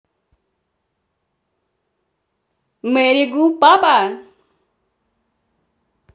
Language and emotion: Russian, positive